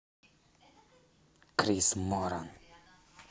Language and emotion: Russian, angry